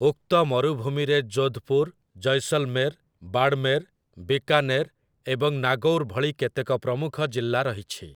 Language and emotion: Odia, neutral